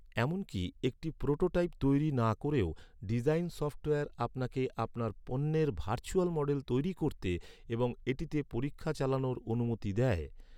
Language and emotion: Bengali, neutral